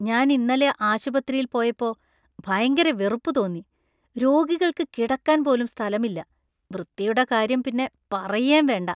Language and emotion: Malayalam, disgusted